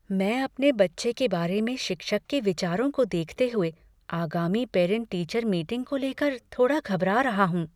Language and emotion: Hindi, fearful